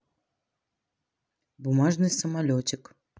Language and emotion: Russian, neutral